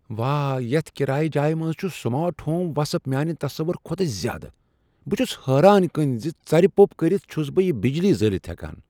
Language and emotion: Kashmiri, surprised